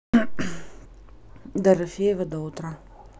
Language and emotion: Russian, neutral